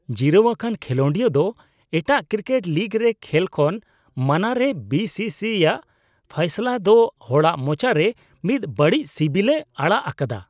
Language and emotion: Santali, disgusted